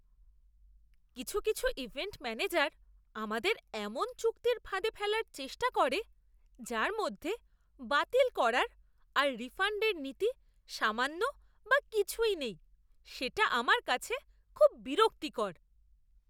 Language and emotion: Bengali, disgusted